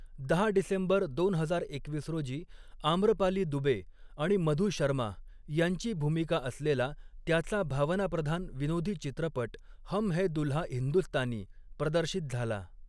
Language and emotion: Marathi, neutral